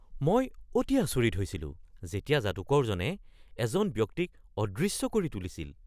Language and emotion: Assamese, surprised